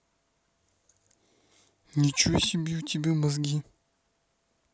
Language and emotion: Russian, angry